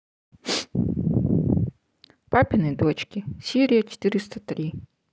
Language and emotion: Russian, neutral